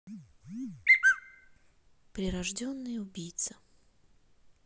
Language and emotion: Russian, neutral